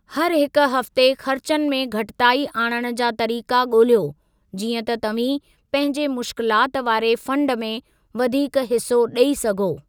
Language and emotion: Sindhi, neutral